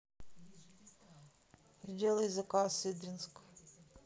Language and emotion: Russian, neutral